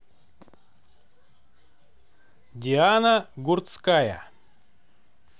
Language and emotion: Russian, neutral